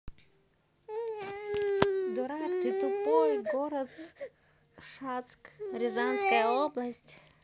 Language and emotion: Russian, neutral